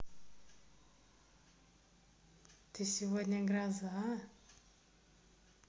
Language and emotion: Russian, positive